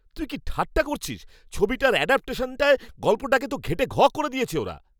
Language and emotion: Bengali, angry